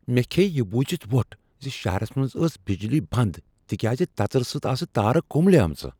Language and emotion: Kashmiri, surprised